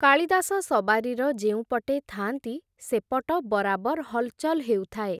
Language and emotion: Odia, neutral